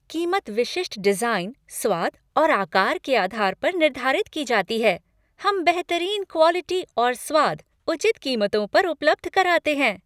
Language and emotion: Hindi, happy